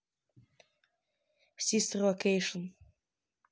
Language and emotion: Russian, neutral